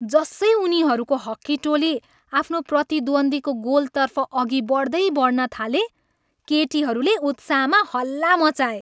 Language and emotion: Nepali, happy